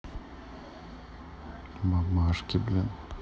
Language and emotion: Russian, neutral